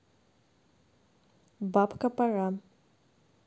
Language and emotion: Russian, neutral